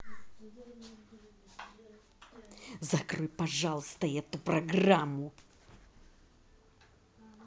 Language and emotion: Russian, angry